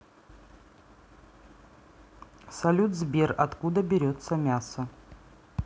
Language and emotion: Russian, neutral